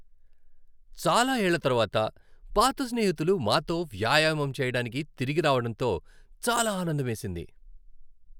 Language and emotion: Telugu, happy